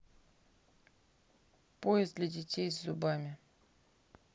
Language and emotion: Russian, neutral